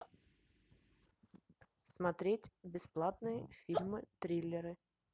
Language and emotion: Russian, neutral